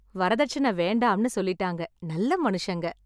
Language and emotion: Tamil, happy